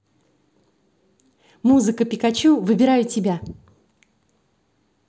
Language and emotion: Russian, positive